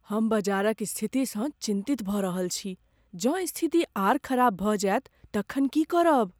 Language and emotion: Maithili, fearful